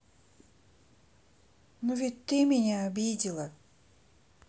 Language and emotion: Russian, sad